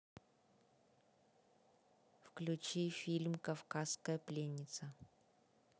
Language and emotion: Russian, neutral